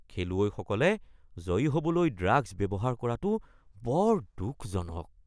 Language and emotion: Assamese, disgusted